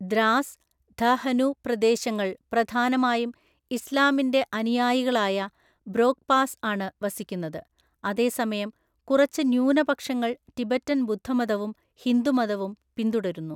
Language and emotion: Malayalam, neutral